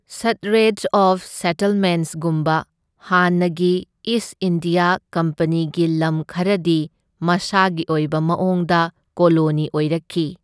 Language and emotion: Manipuri, neutral